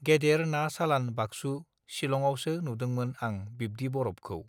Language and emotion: Bodo, neutral